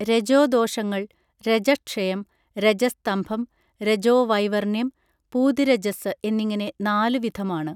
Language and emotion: Malayalam, neutral